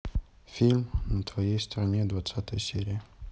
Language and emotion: Russian, neutral